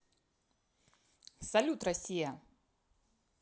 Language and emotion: Russian, positive